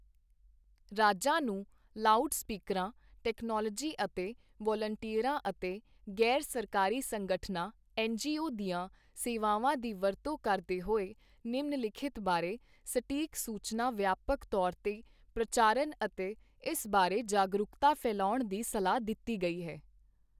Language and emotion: Punjabi, neutral